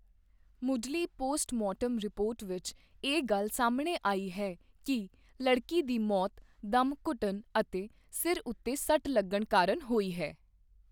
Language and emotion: Punjabi, neutral